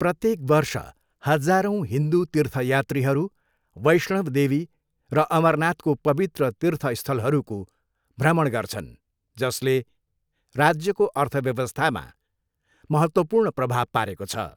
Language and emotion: Nepali, neutral